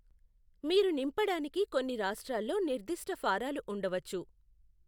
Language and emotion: Telugu, neutral